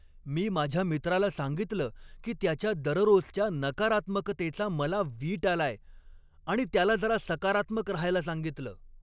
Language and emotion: Marathi, angry